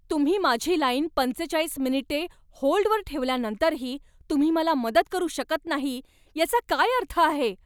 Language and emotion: Marathi, angry